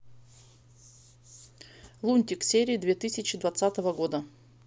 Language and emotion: Russian, neutral